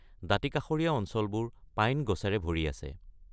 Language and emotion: Assamese, neutral